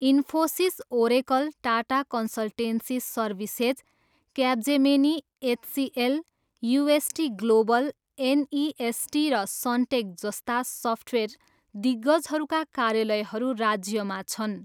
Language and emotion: Nepali, neutral